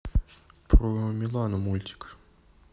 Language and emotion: Russian, neutral